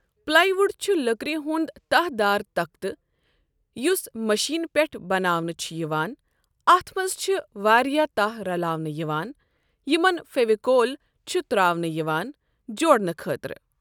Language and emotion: Kashmiri, neutral